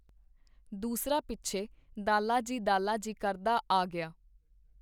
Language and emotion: Punjabi, neutral